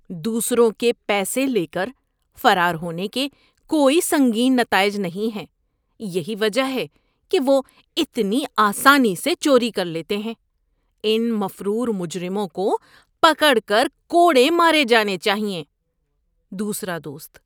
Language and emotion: Urdu, disgusted